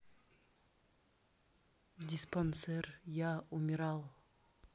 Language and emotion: Russian, neutral